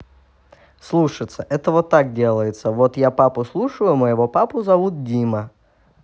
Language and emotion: Russian, neutral